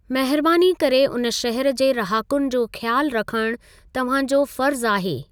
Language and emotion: Sindhi, neutral